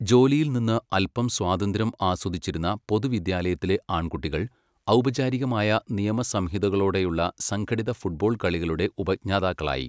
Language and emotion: Malayalam, neutral